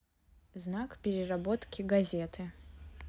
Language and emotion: Russian, neutral